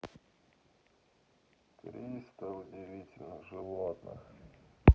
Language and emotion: Russian, sad